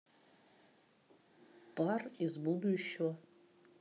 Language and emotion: Russian, neutral